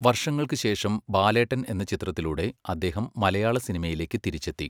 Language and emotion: Malayalam, neutral